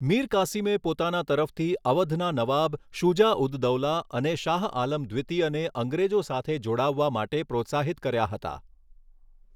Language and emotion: Gujarati, neutral